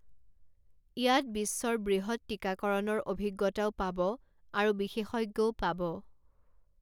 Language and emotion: Assamese, neutral